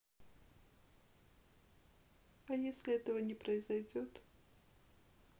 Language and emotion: Russian, sad